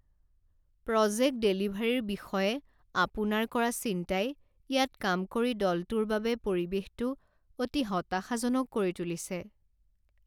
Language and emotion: Assamese, sad